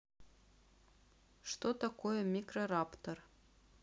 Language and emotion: Russian, neutral